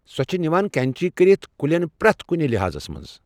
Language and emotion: Kashmiri, neutral